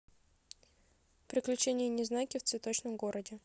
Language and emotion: Russian, neutral